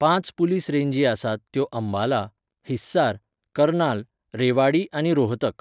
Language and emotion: Goan Konkani, neutral